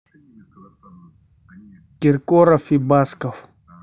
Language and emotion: Russian, neutral